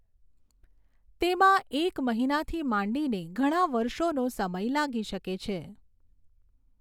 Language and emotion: Gujarati, neutral